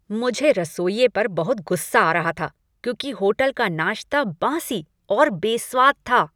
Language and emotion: Hindi, angry